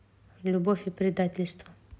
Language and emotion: Russian, neutral